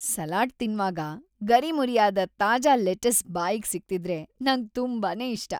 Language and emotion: Kannada, happy